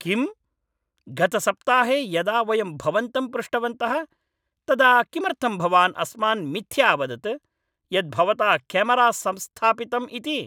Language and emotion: Sanskrit, angry